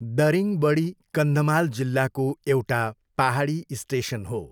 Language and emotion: Nepali, neutral